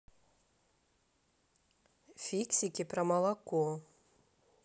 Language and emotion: Russian, neutral